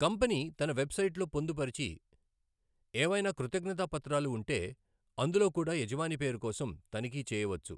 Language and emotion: Telugu, neutral